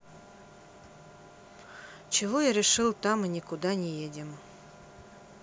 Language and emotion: Russian, neutral